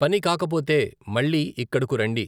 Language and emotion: Telugu, neutral